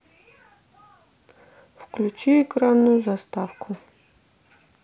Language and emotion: Russian, neutral